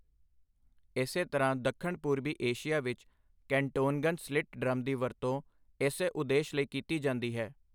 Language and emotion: Punjabi, neutral